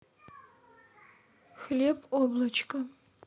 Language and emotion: Russian, neutral